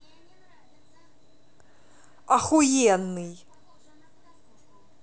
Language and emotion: Russian, angry